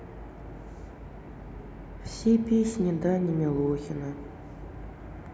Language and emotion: Russian, sad